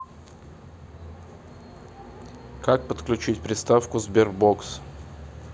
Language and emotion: Russian, neutral